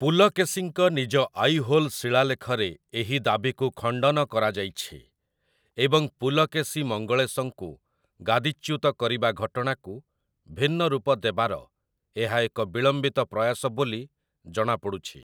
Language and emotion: Odia, neutral